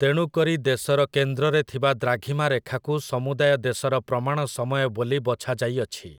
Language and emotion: Odia, neutral